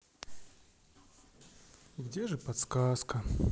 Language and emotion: Russian, sad